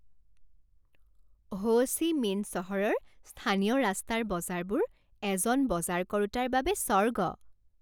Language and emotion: Assamese, happy